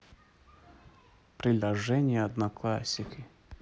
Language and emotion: Russian, neutral